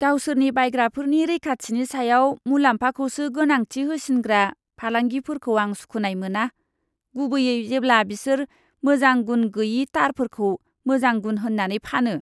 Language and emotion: Bodo, disgusted